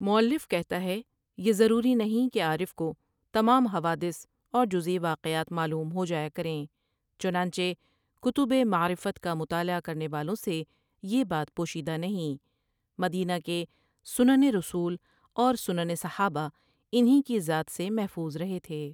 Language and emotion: Urdu, neutral